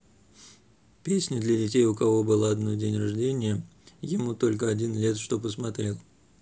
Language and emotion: Russian, neutral